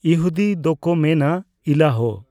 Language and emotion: Santali, neutral